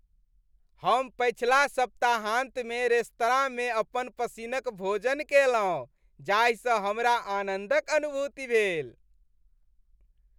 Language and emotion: Maithili, happy